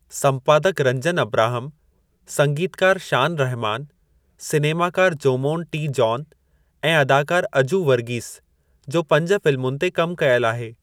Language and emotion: Sindhi, neutral